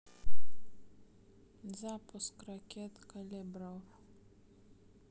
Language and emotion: Russian, neutral